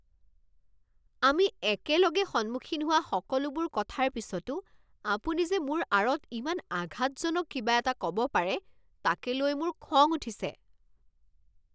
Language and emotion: Assamese, angry